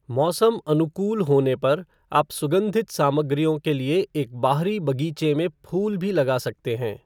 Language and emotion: Hindi, neutral